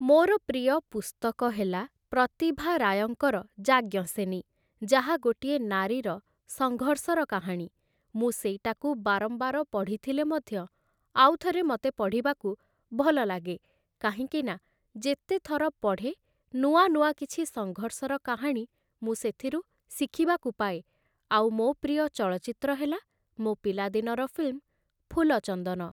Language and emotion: Odia, neutral